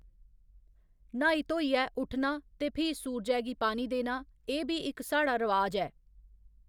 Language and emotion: Dogri, neutral